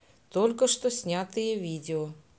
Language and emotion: Russian, neutral